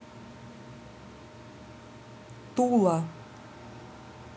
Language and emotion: Russian, neutral